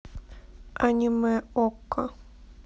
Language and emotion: Russian, neutral